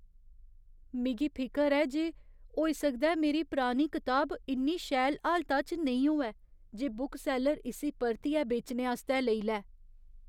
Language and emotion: Dogri, fearful